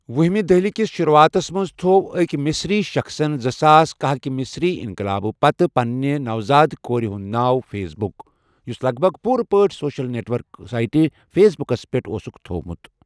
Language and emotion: Kashmiri, neutral